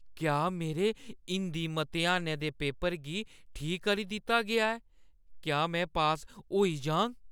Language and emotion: Dogri, fearful